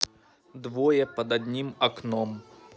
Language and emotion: Russian, neutral